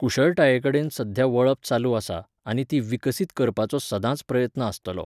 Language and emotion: Goan Konkani, neutral